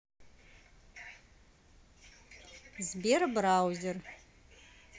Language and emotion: Russian, neutral